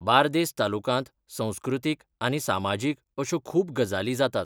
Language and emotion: Goan Konkani, neutral